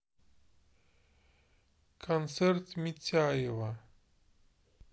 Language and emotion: Russian, neutral